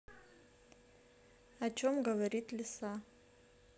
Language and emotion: Russian, neutral